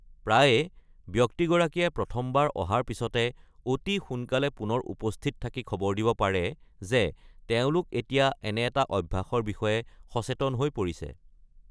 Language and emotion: Assamese, neutral